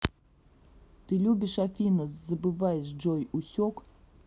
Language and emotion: Russian, angry